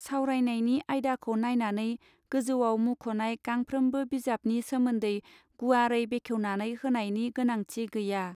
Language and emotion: Bodo, neutral